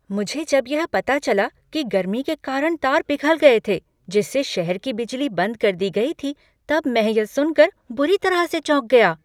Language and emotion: Hindi, surprised